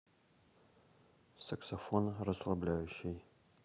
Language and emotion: Russian, neutral